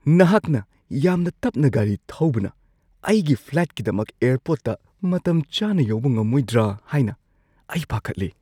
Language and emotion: Manipuri, fearful